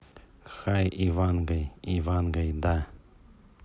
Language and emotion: Russian, neutral